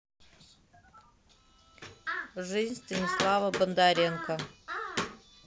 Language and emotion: Russian, neutral